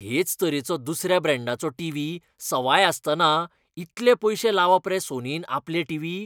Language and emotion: Goan Konkani, disgusted